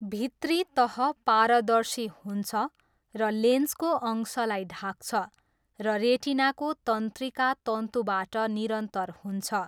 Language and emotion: Nepali, neutral